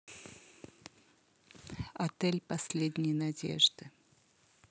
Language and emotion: Russian, neutral